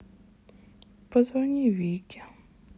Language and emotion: Russian, sad